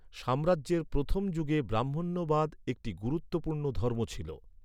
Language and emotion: Bengali, neutral